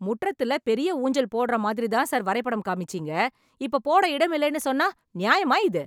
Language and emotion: Tamil, angry